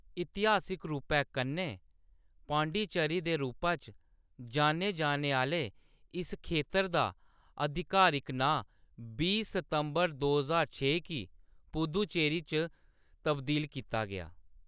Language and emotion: Dogri, neutral